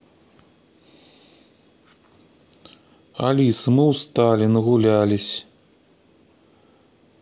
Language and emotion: Russian, sad